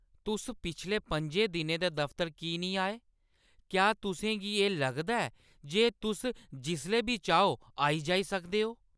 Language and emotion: Dogri, angry